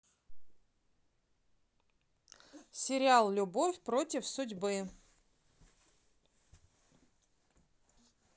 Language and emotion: Russian, neutral